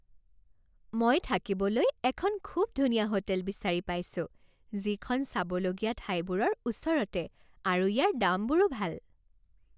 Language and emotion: Assamese, happy